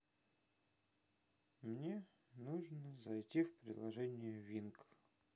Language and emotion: Russian, sad